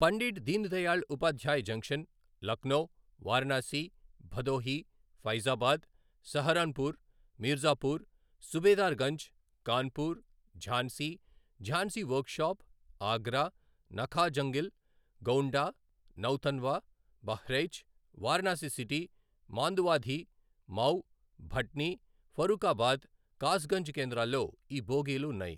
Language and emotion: Telugu, neutral